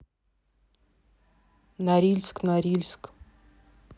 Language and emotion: Russian, neutral